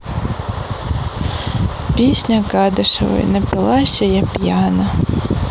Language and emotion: Russian, neutral